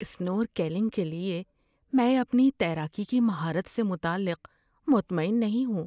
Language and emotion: Urdu, fearful